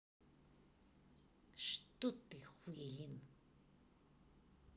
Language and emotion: Russian, angry